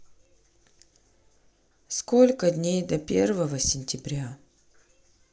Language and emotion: Russian, sad